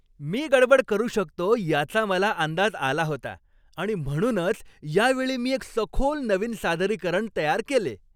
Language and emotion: Marathi, happy